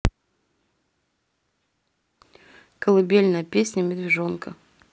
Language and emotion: Russian, neutral